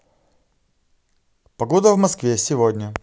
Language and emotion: Russian, positive